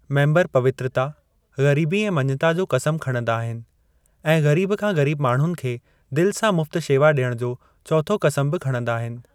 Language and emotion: Sindhi, neutral